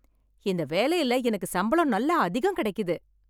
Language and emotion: Tamil, happy